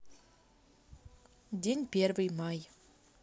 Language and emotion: Russian, neutral